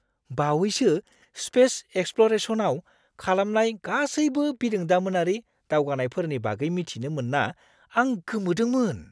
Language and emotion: Bodo, surprised